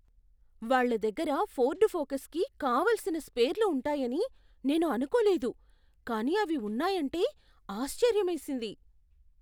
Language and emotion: Telugu, surprised